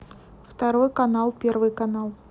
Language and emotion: Russian, neutral